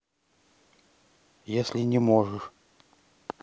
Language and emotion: Russian, neutral